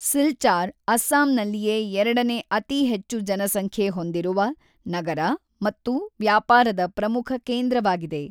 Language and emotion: Kannada, neutral